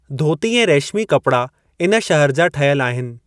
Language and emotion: Sindhi, neutral